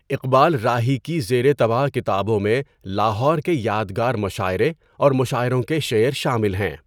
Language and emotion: Urdu, neutral